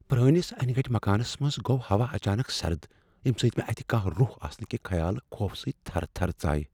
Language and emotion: Kashmiri, fearful